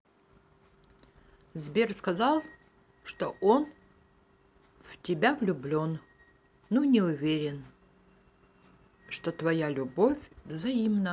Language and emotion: Russian, neutral